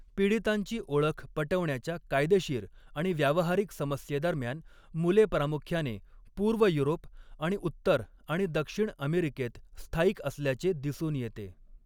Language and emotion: Marathi, neutral